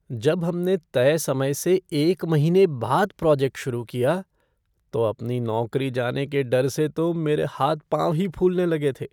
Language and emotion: Hindi, fearful